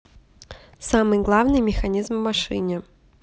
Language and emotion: Russian, neutral